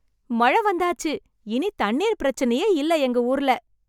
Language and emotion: Tamil, happy